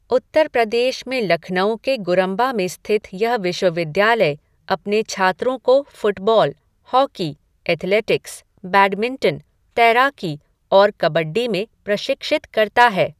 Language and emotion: Hindi, neutral